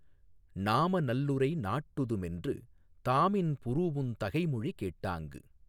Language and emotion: Tamil, neutral